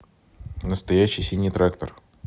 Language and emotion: Russian, neutral